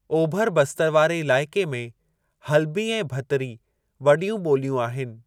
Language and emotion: Sindhi, neutral